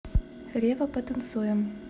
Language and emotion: Russian, neutral